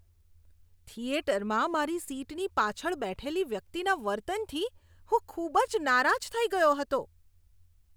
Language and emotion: Gujarati, disgusted